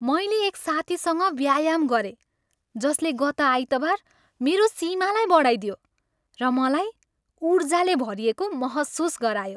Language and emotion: Nepali, happy